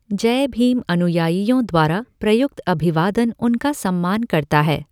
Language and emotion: Hindi, neutral